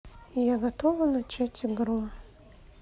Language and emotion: Russian, sad